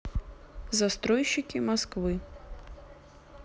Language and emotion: Russian, neutral